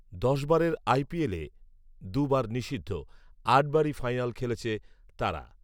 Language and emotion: Bengali, neutral